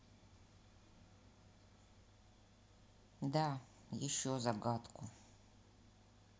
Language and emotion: Russian, neutral